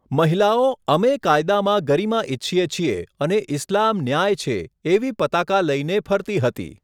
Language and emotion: Gujarati, neutral